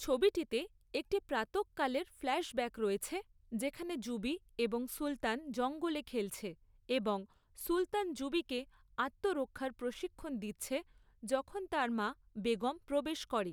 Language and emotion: Bengali, neutral